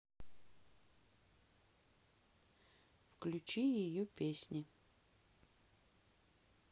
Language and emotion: Russian, neutral